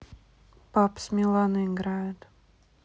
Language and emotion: Russian, neutral